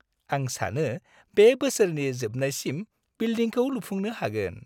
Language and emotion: Bodo, happy